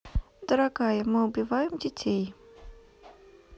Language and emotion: Russian, neutral